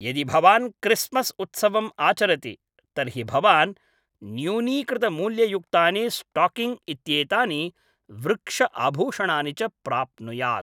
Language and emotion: Sanskrit, neutral